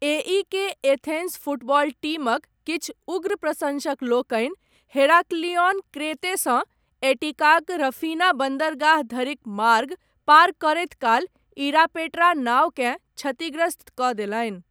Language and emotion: Maithili, neutral